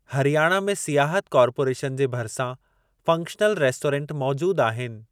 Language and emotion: Sindhi, neutral